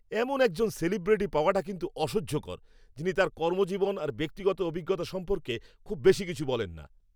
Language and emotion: Bengali, angry